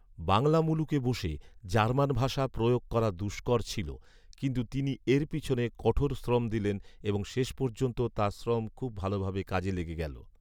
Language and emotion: Bengali, neutral